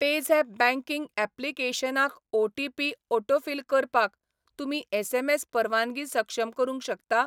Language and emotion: Goan Konkani, neutral